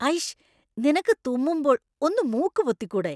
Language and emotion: Malayalam, disgusted